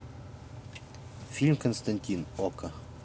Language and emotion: Russian, neutral